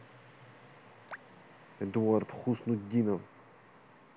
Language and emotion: Russian, neutral